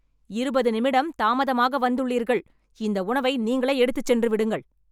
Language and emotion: Tamil, angry